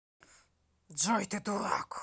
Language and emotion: Russian, angry